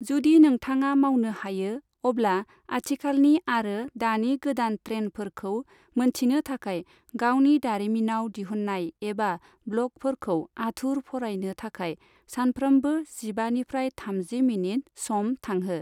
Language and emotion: Bodo, neutral